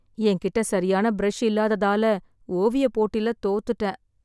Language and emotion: Tamil, sad